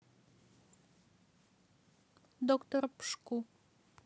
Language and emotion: Russian, neutral